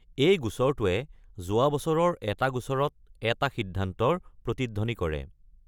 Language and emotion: Assamese, neutral